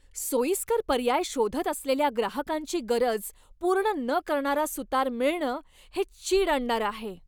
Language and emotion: Marathi, angry